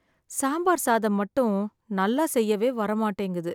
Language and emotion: Tamil, sad